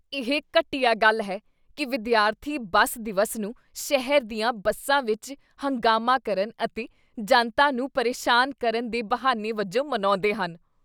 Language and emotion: Punjabi, disgusted